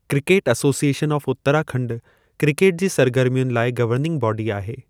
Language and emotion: Sindhi, neutral